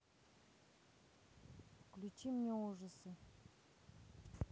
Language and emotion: Russian, neutral